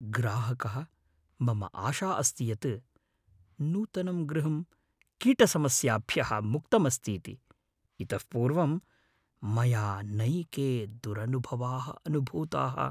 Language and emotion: Sanskrit, fearful